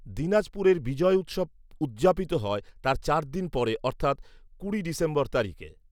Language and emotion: Bengali, neutral